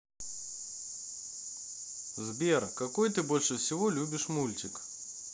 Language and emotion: Russian, neutral